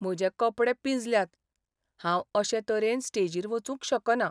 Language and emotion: Goan Konkani, sad